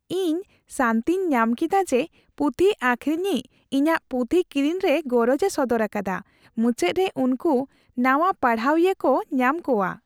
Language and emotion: Santali, happy